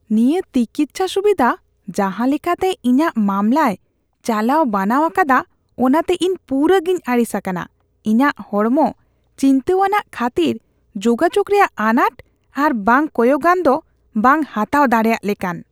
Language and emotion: Santali, disgusted